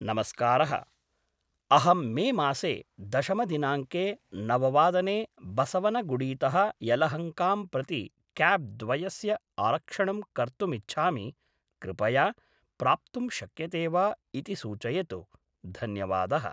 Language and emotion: Sanskrit, neutral